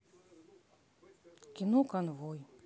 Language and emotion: Russian, neutral